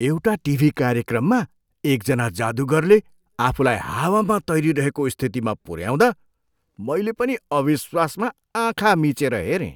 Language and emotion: Nepali, surprised